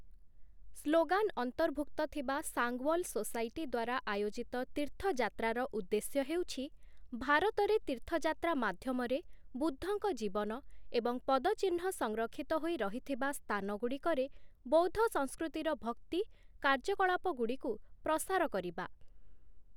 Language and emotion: Odia, neutral